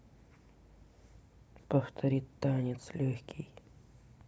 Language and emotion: Russian, neutral